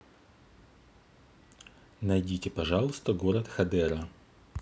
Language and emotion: Russian, neutral